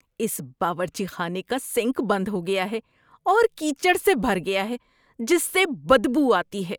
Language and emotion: Urdu, disgusted